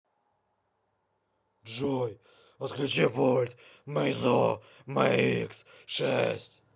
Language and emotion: Russian, angry